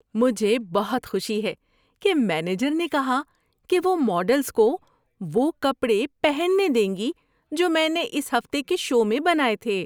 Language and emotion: Urdu, happy